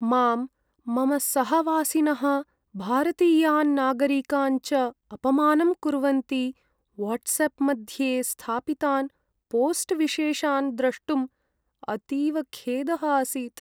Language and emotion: Sanskrit, sad